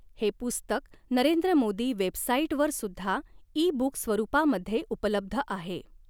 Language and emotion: Marathi, neutral